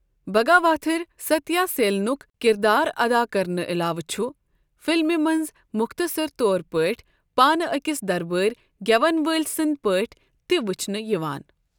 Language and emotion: Kashmiri, neutral